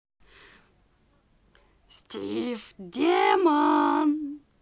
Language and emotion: Russian, positive